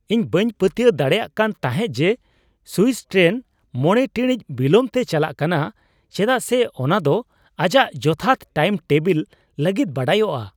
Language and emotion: Santali, surprised